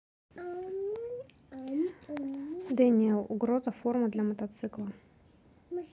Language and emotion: Russian, neutral